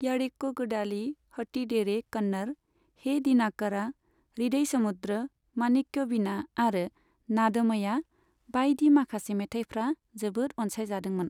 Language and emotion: Bodo, neutral